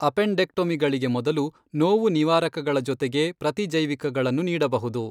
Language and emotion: Kannada, neutral